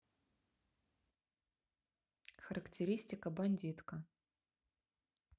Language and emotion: Russian, neutral